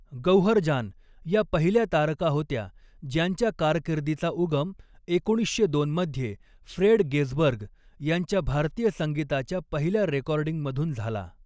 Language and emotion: Marathi, neutral